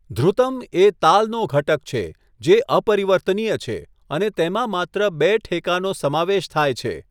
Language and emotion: Gujarati, neutral